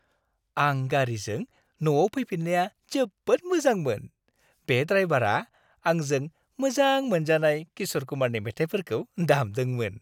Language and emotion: Bodo, happy